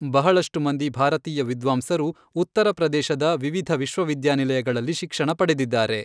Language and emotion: Kannada, neutral